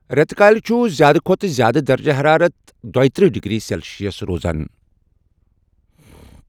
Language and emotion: Kashmiri, neutral